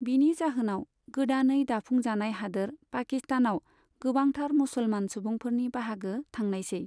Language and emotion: Bodo, neutral